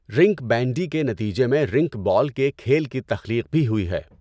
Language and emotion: Urdu, neutral